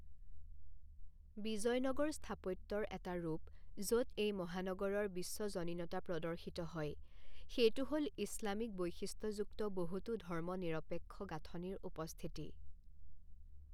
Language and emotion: Assamese, neutral